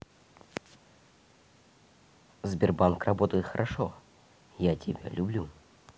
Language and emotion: Russian, neutral